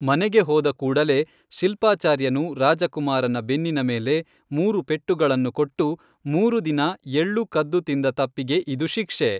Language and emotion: Kannada, neutral